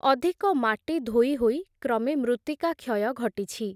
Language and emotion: Odia, neutral